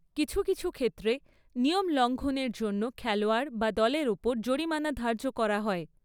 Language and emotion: Bengali, neutral